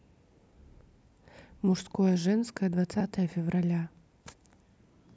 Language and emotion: Russian, neutral